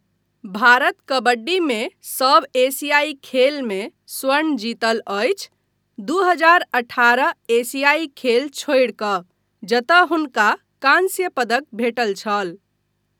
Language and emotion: Maithili, neutral